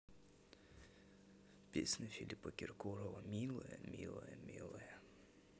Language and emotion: Russian, sad